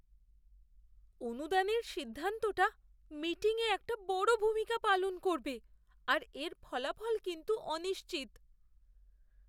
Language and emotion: Bengali, fearful